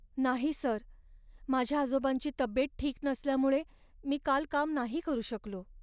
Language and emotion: Marathi, sad